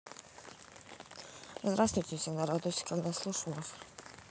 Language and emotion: Russian, neutral